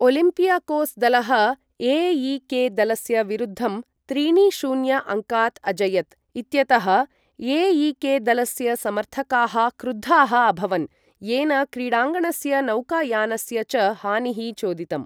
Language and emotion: Sanskrit, neutral